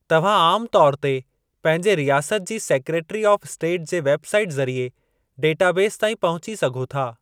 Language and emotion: Sindhi, neutral